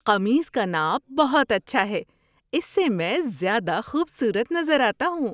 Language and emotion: Urdu, happy